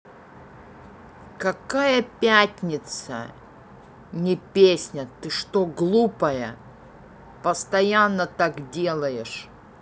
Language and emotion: Russian, angry